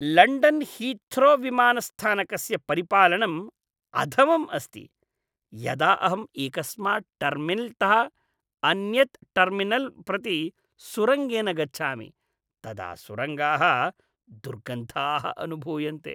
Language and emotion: Sanskrit, disgusted